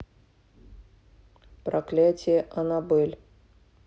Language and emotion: Russian, neutral